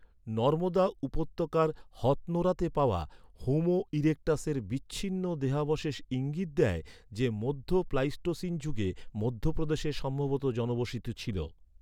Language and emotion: Bengali, neutral